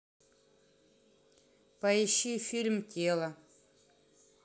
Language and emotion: Russian, neutral